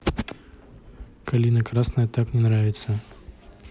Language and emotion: Russian, neutral